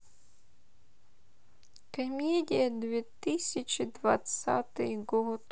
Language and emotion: Russian, sad